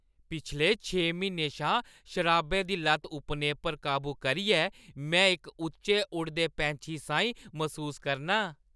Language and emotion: Dogri, happy